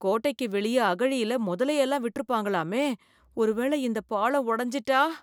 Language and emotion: Tamil, fearful